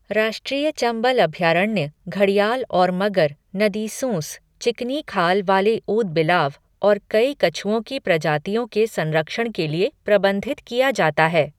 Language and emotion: Hindi, neutral